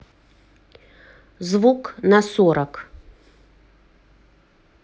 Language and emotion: Russian, neutral